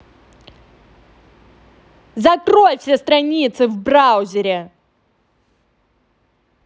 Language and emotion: Russian, angry